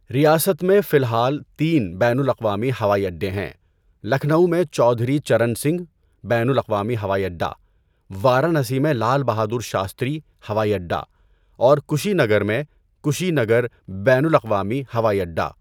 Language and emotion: Urdu, neutral